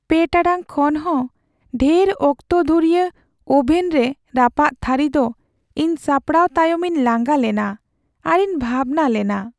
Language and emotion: Santali, sad